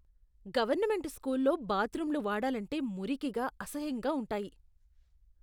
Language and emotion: Telugu, disgusted